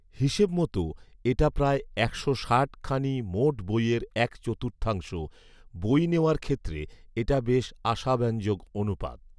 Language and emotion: Bengali, neutral